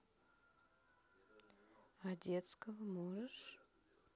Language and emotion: Russian, neutral